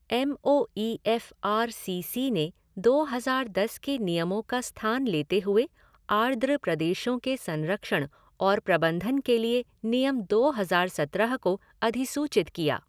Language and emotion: Hindi, neutral